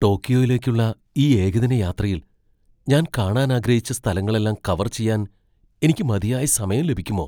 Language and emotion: Malayalam, fearful